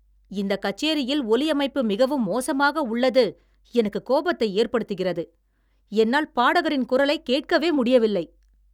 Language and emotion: Tamil, angry